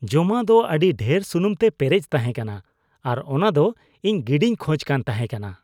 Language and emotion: Santali, disgusted